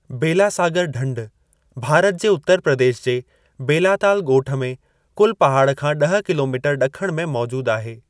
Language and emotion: Sindhi, neutral